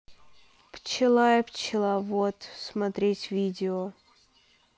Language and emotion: Russian, neutral